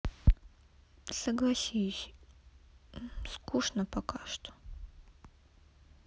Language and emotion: Russian, sad